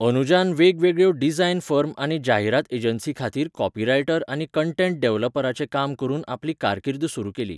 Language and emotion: Goan Konkani, neutral